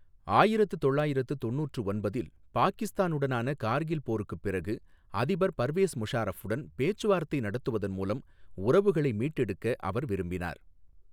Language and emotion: Tamil, neutral